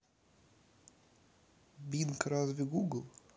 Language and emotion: Russian, neutral